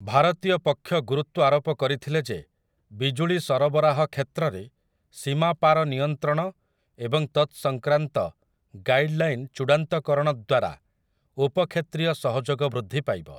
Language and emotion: Odia, neutral